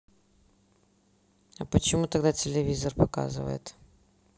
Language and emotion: Russian, neutral